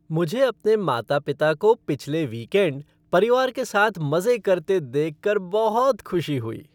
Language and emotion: Hindi, happy